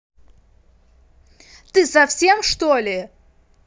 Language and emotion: Russian, angry